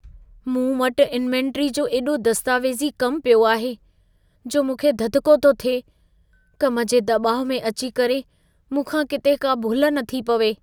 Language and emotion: Sindhi, fearful